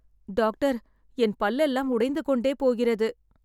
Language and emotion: Tamil, sad